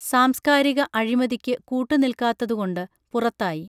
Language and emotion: Malayalam, neutral